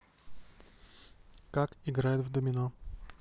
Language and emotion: Russian, neutral